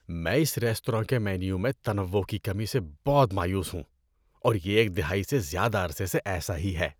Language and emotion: Urdu, disgusted